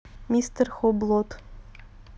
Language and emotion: Russian, neutral